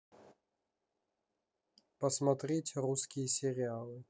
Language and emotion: Russian, neutral